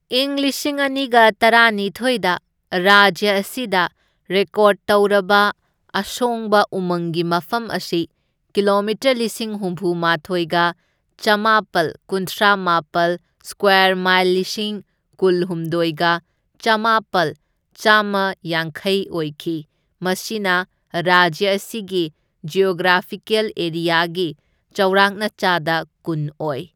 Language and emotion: Manipuri, neutral